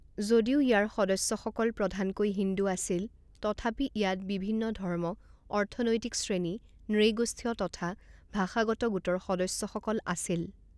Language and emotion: Assamese, neutral